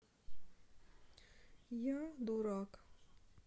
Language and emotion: Russian, sad